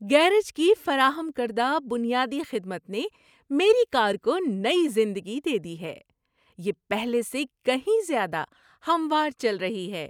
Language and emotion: Urdu, happy